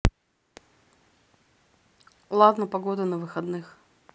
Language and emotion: Russian, neutral